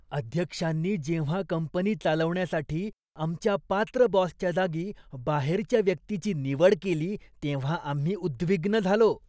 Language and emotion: Marathi, disgusted